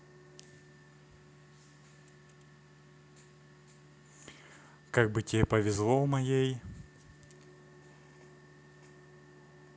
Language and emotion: Russian, neutral